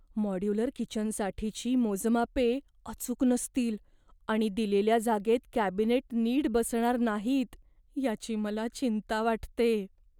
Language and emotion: Marathi, fearful